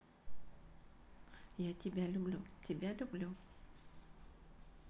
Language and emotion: Russian, neutral